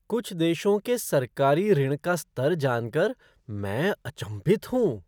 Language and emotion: Hindi, surprised